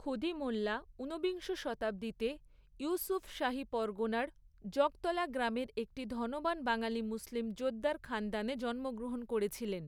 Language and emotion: Bengali, neutral